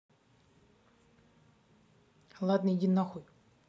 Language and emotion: Russian, angry